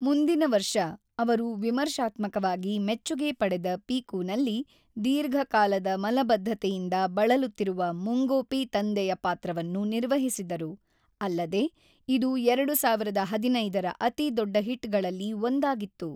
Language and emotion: Kannada, neutral